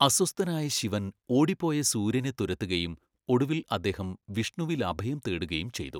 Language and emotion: Malayalam, neutral